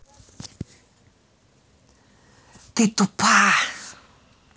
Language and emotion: Russian, angry